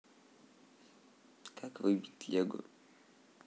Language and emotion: Russian, neutral